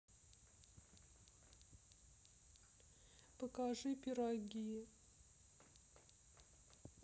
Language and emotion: Russian, sad